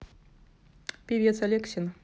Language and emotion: Russian, neutral